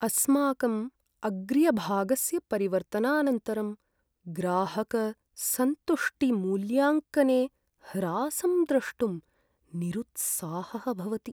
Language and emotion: Sanskrit, sad